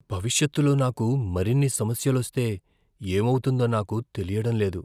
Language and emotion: Telugu, fearful